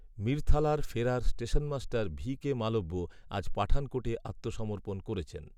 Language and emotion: Bengali, neutral